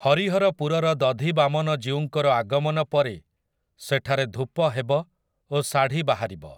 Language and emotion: Odia, neutral